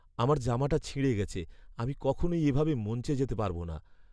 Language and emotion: Bengali, sad